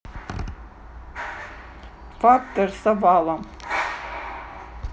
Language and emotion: Russian, neutral